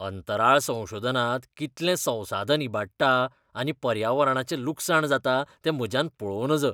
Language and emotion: Goan Konkani, disgusted